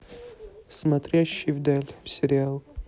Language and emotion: Russian, neutral